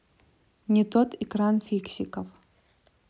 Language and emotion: Russian, neutral